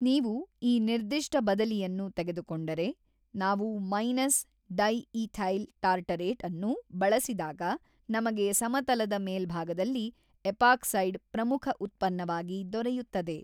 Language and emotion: Kannada, neutral